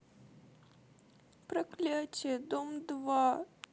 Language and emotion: Russian, sad